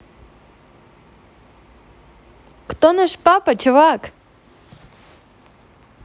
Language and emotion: Russian, positive